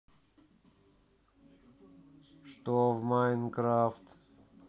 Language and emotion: Russian, sad